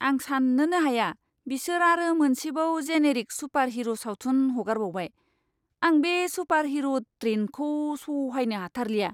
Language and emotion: Bodo, disgusted